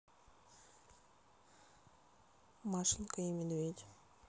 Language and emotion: Russian, neutral